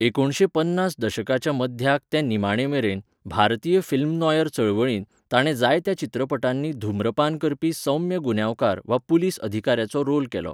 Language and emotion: Goan Konkani, neutral